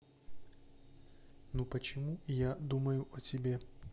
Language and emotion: Russian, neutral